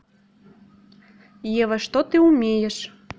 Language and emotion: Russian, neutral